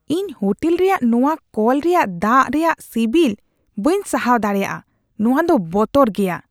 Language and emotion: Santali, disgusted